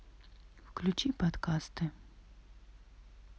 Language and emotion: Russian, neutral